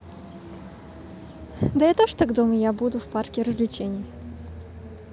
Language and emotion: Russian, positive